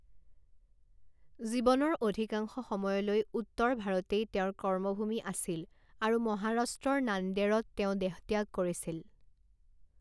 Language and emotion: Assamese, neutral